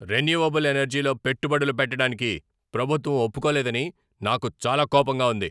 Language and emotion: Telugu, angry